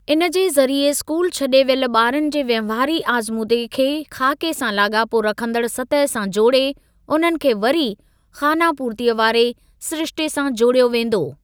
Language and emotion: Sindhi, neutral